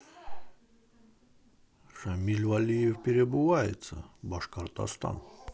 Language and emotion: Russian, positive